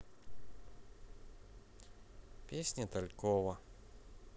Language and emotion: Russian, neutral